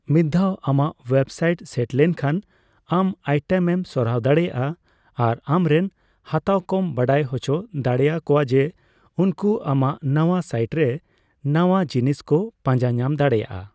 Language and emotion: Santali, neutral